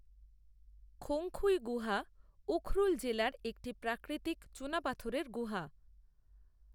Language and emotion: Bengali, neutral